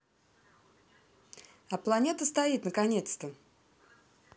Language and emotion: Russian, neutral